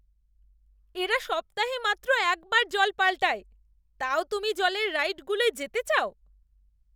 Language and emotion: Bengali, disgusted